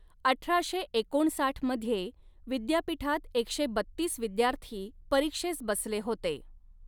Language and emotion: Marathi, neutral